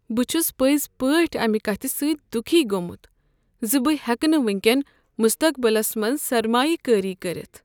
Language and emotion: Kashmiri, sad